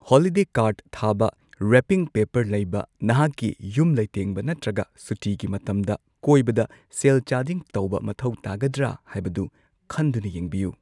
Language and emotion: Manipuri, neutral